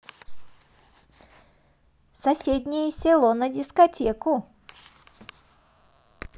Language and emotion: Russian, positive